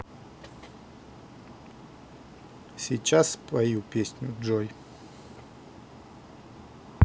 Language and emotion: Russian, neutral